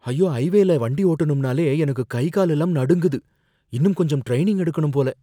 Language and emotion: Tamil, fearful